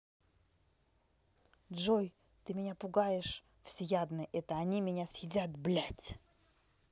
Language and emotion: Russian, angry